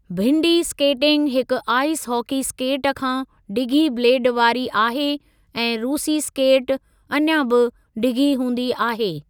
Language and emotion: Sindhi, neutral